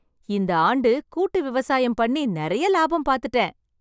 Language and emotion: Tamil, happy